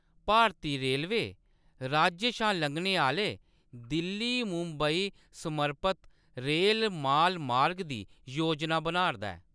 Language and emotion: Dogri, neutral